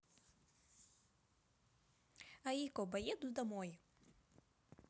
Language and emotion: Russian, neutral